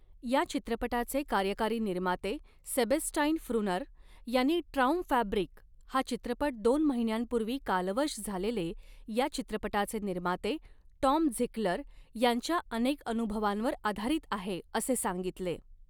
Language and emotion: Marathi, neutral